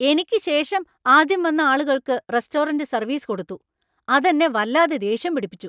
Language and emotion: Malayalam, angry